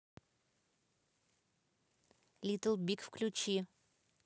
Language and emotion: Russian, neutral